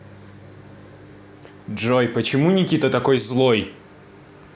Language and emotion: Russian, angry